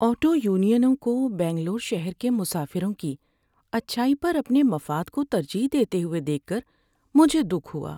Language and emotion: Urdu, sad